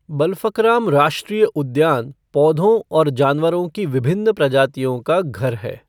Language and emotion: Hindi, neutral